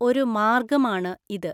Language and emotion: Malayalam, neutral